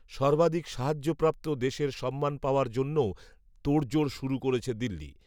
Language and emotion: Bengali, neutral